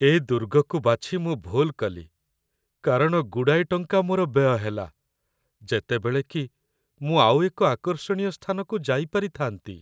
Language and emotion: Odia, sad